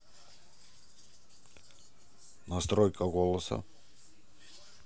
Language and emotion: Russian, neutral